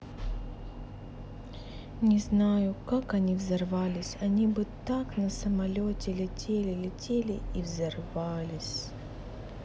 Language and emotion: Russian, sad